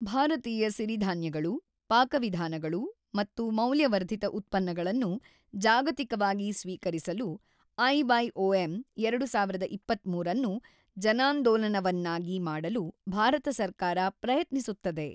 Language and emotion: Kannada, neutral